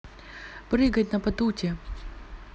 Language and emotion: Russian, neutral